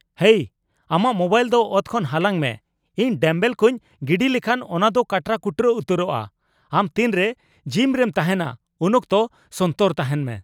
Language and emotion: Santali, angry